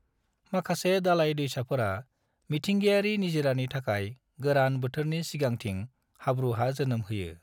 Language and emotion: Bodo, neutral